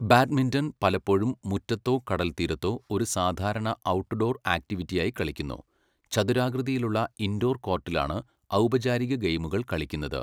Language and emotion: Malayalam, neutral